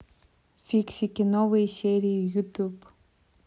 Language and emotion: Russian, neutral